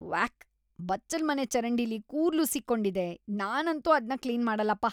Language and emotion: Kannada, disgusted